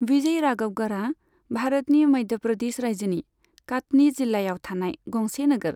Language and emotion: Bodo, neutral